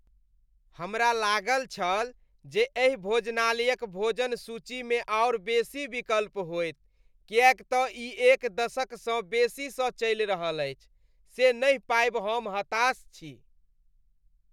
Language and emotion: Maithili, disgusted